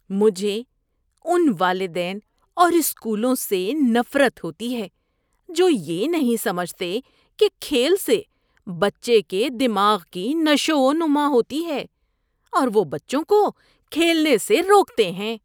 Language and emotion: Urdu, disgusted